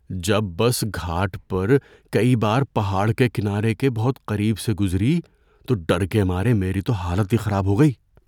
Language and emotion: Urdu, fearful